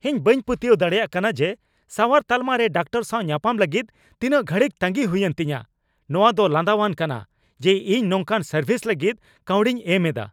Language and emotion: Santali, angry